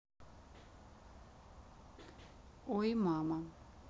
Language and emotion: Russian, neutral